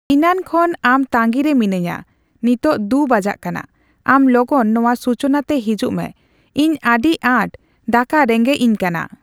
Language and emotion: Santali, neutral